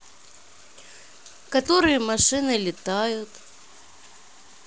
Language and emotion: Russian, sad